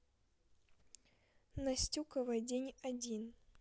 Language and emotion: Russian, neutral